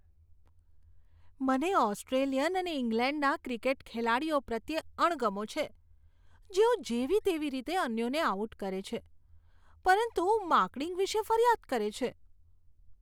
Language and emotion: Gujarati, disgusted